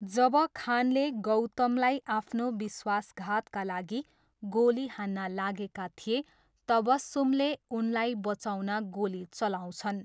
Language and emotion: Nepali, neutral